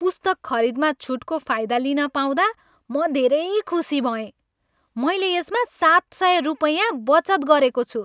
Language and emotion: Nepali, happy